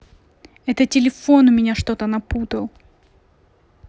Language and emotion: Russian, angry